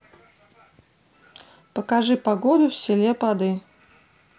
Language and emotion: Russian, neutral